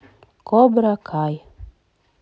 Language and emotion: Russian, neutral